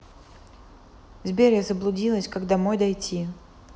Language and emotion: Russian, neutral